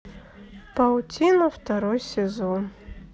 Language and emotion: Russian, neutral